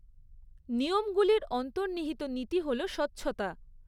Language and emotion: Bengali, neutral